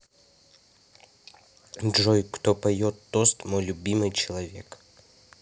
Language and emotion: Russian, neutral